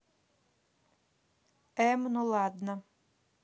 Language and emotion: Russian, neutral